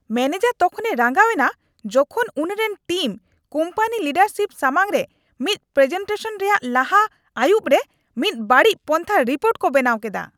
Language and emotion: Santali, angry